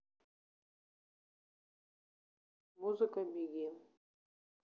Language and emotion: Russian, neutral